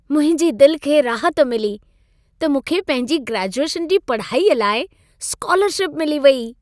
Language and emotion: Sindhi, happy